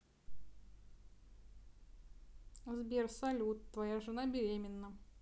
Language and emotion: Russian, neutral